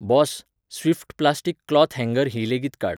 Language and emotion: Goan Konkani, neutral